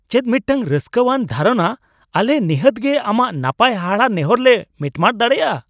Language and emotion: Santali, surprised